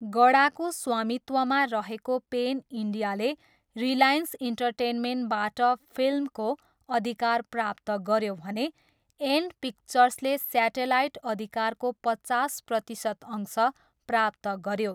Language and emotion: Nepali, neutral